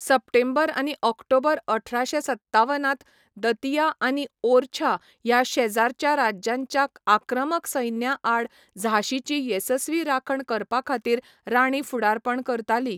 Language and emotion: Goan Konkani, neutral